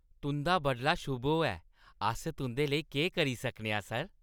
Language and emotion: Dogri, happy